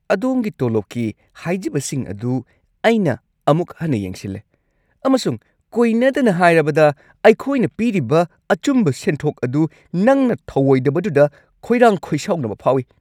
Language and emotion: Manipuri, angry